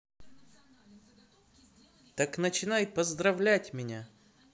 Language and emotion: Russian, positive